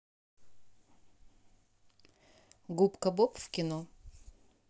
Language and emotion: Russian, neutral